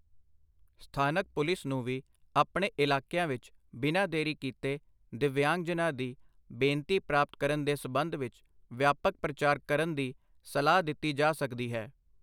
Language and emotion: Punjabi, neutral